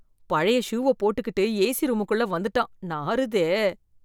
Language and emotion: Tamil, disgusted